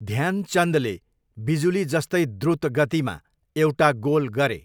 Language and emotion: Nepali, neutral